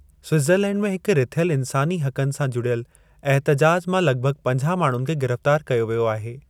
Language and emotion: Sindhi, neutral